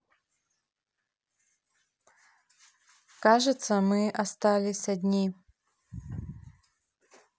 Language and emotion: Russian, neutral